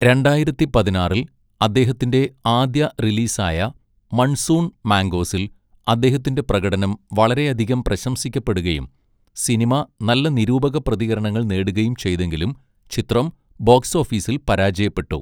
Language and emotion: Malayalam, neutral